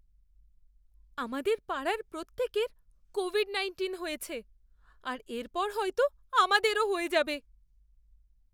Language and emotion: Bengali, fearful